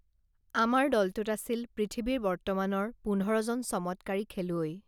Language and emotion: Assamese, neutral